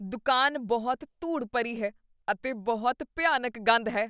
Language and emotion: Punjabi, disgusted